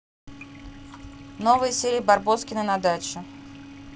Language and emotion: Russian, neutral